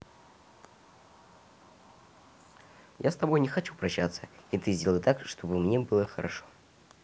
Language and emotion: Russian, neutral